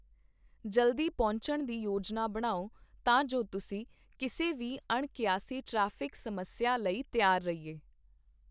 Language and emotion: Punjabi, neutral